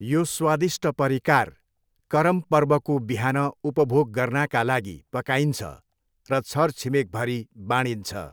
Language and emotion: Nepali, neutral